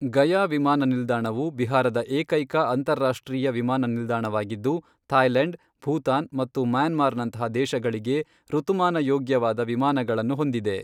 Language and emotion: Kannada, neutral